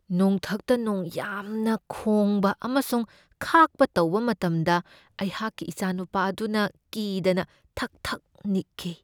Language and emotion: Manipuri, fearful